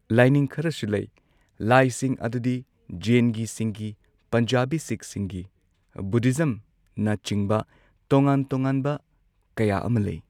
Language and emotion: Manipuri, neutral